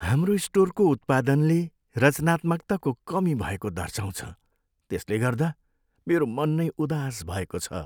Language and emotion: Nepali, sad